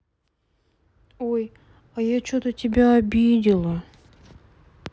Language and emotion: Russian, sad